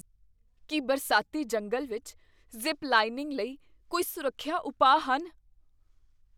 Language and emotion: Punjabi, fearful